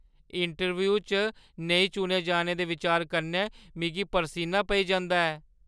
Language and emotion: Dogri, fearful